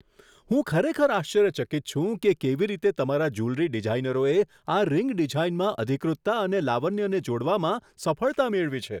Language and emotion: Gujarati, surprised